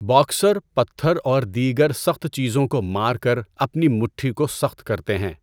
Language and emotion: Urdu, neutral